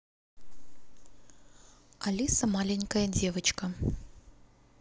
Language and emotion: Russian, neutral